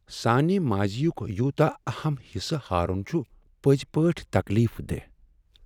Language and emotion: Kashmiri, sad